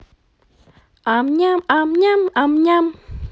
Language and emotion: Russian, positive